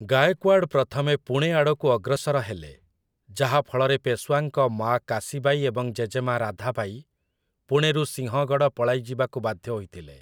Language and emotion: Odia, neutral